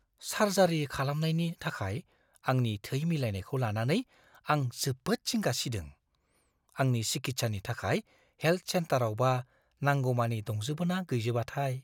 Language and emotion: Bodo, fearful